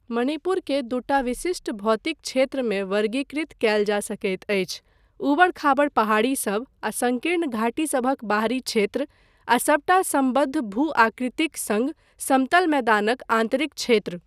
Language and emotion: Maithili, neutral